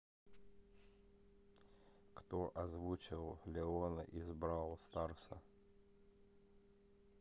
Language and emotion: Russian, neutral